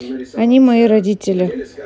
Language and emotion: Russian, neutral